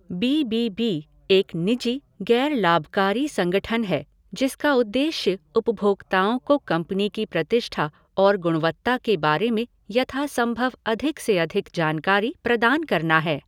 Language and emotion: Hindi, neutral